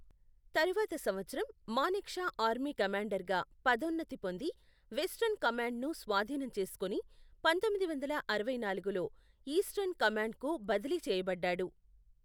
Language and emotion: Telugu, neutral